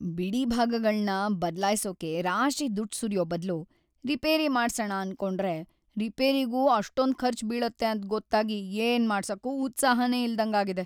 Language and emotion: Kannada, sad